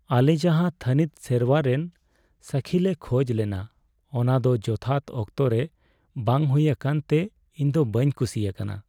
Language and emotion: Santali, sad